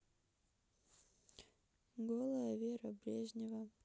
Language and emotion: Russian, sad